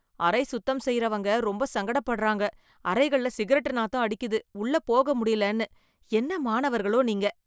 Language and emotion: Tamil, disgusted